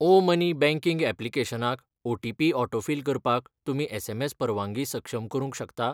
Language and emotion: Goan Konkani, neutral